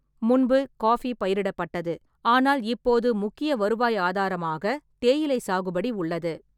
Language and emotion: Tamil, neutral